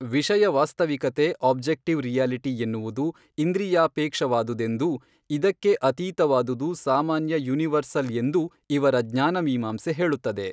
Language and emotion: Kannada, neutral